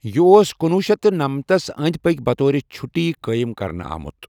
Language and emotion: Kashmiri, neutral